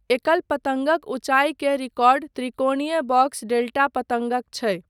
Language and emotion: Maithili, neutral